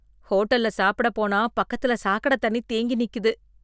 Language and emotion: Tamil, disgusted